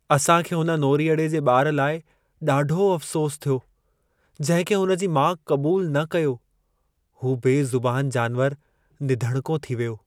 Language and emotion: Sindhi, sad